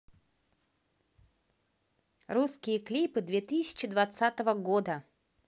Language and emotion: Russian, positive